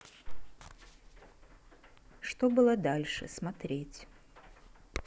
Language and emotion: Russian, neutral